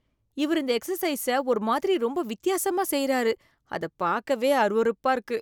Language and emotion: Tamil, disgusted